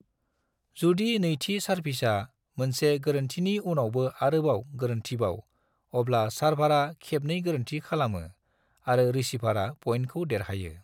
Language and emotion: Bodo, neutral